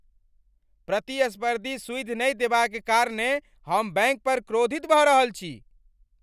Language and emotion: Maithili, angry